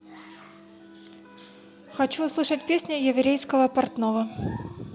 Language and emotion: Russian, neutral